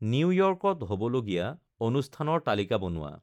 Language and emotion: Assamese, neutral